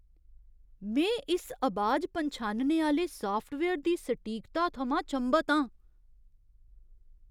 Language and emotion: Dogri, surprised